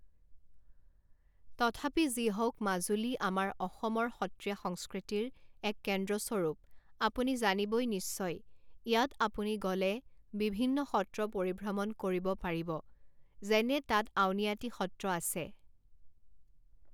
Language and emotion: Assamese, neutral